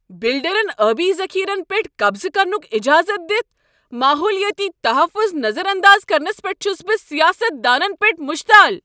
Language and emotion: Kashmiri, angry